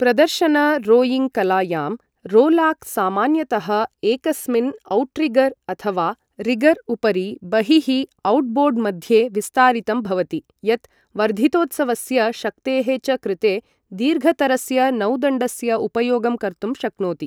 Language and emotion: Sanskrit, neutral